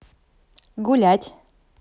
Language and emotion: Russian, positive